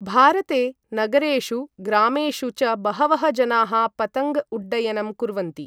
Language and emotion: Sanskrit, neutral